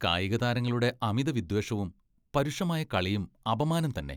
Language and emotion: Malayalam, disgusted